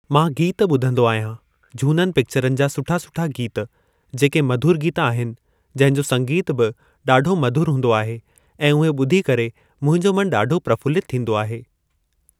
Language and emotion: Sindhi, neutral